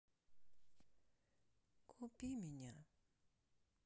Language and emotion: Russian, sad